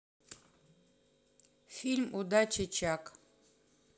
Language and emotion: Russian, neutral